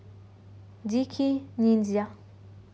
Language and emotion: Russian, neutral